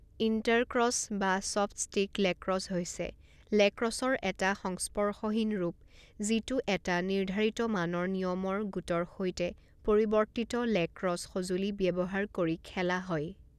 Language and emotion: Assamese, neutral